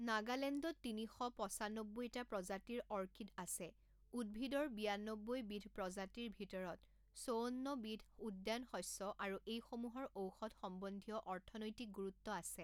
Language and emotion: Assamese, neutral